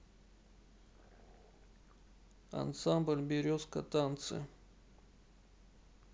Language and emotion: Russian, sad